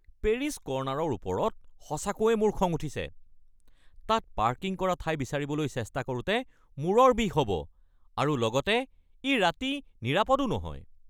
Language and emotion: Assamese, angry